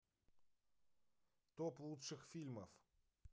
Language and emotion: Russian, neutral